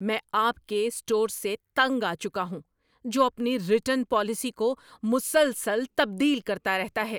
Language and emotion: Urdu, angry